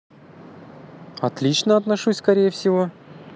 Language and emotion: Russian, positive